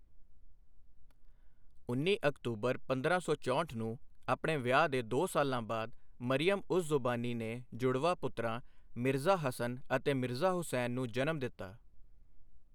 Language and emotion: Punjabi, neutral